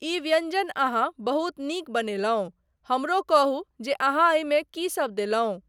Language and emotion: Maithili, neutral